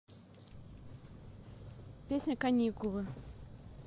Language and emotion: Russian, neutral